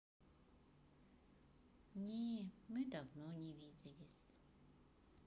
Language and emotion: Russian, sad